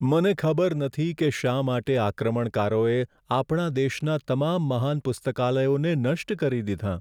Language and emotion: Gujarati, sad